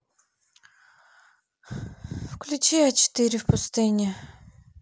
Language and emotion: Russian, sad